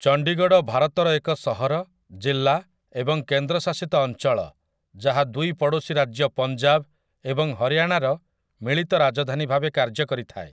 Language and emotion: Odia, neutral